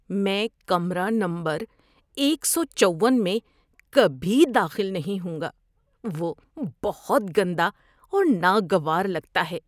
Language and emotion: Urdu, disgusted